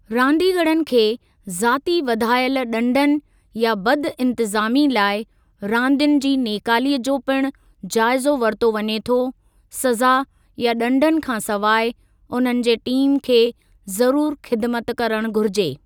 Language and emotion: Sindhi, neutral